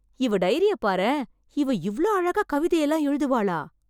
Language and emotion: Tamil, surprised